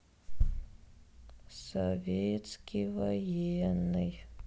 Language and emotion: Russian, sad